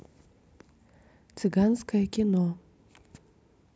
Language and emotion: Russian, neutral